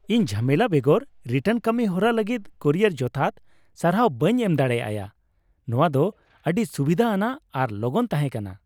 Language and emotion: Santali, happy